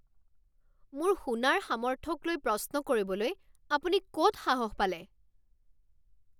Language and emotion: Assamese, angry